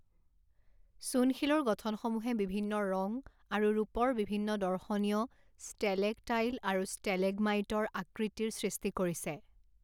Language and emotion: Assamese, neutral